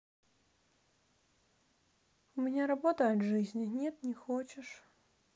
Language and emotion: Russian, sad